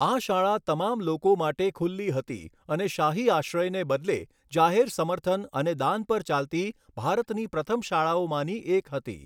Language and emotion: Gujarati, neutral